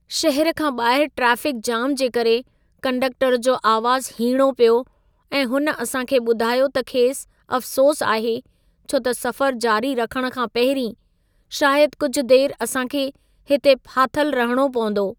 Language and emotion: Sindhi, sad